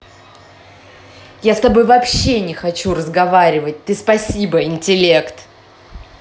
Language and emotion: Russian, angry